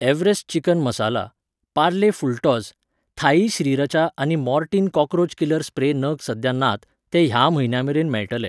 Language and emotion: Goan Konkani, neutral